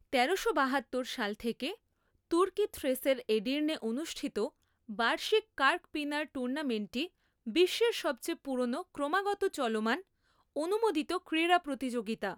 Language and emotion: Bengali, neutral